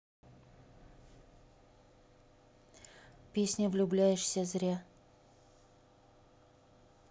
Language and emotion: Russian, neutral